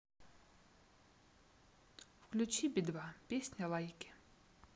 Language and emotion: Russian, neutral